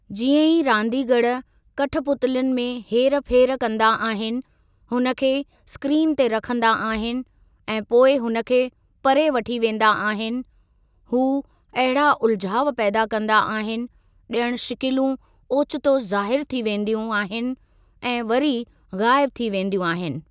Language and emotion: Sindhi, neutral